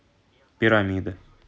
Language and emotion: Russian, neutral